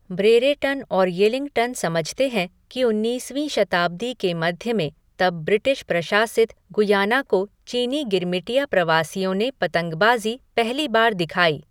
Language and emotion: Hindi, neutral